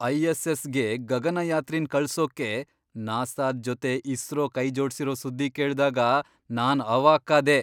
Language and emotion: Kannada, surprised